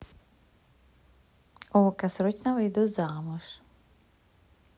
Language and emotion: Russian, positive